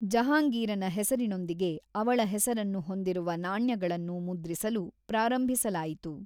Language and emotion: Kannada, neutral